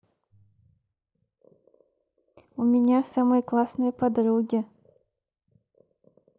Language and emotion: Russian, positive